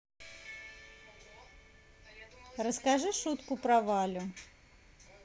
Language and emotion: Russian, positive